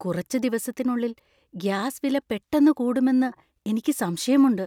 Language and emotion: Malayalam, fearful